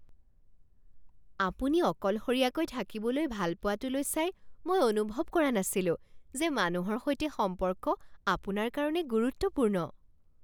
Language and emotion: Assamese, surprised